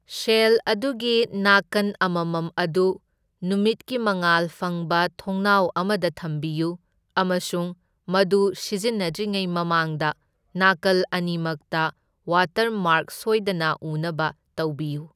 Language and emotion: Manipuri, neutral